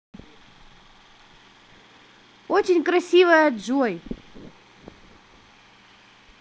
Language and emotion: Russian, positive